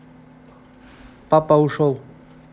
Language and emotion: Russian, neutral